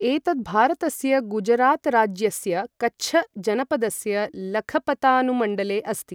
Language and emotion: Sanskrit, neutral